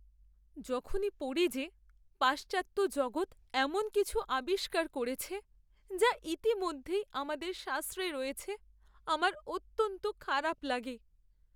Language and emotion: Bengali, sad